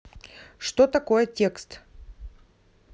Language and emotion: Russian, neutral